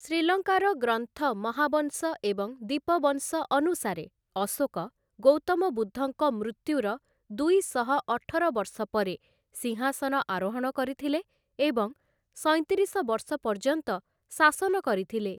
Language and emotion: Odia, neutral